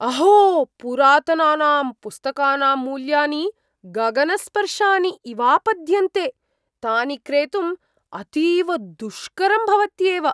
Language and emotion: Sanskrit, surprised